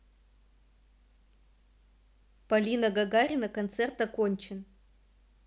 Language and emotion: Russian, neutral